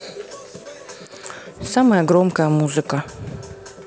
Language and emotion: Russian, neutral